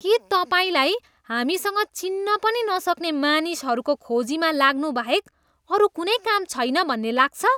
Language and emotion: Nepali, disgusted